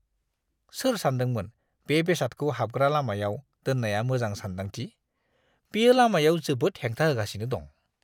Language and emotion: Bodo, disgusted